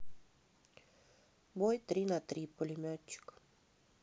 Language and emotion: Russian, neutral